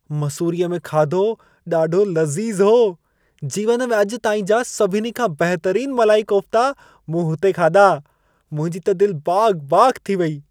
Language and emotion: Sindhi, happy